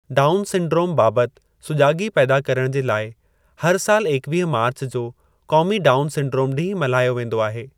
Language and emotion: Sindhi, neutral